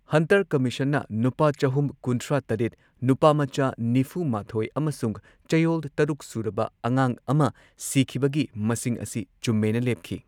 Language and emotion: Manipuri, neutral